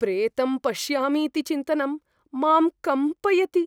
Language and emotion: Sanskrit, fearful